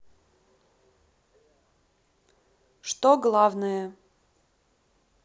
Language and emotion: Russian, neutral